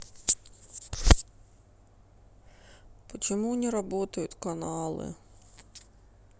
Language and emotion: Russian, sad